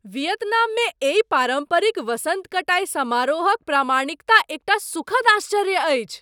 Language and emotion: Maithili, surprised